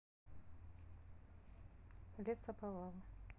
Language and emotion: Russian, neutral